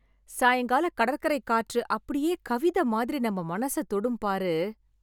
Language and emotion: Tamil, happy